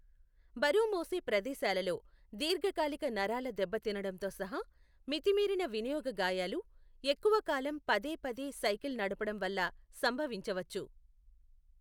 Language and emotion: Telugu, neutral